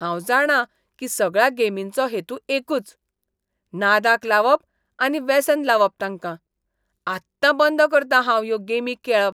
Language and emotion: Goan Konkani, disgusted